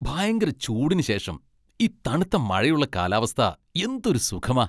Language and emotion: Malayalam, happy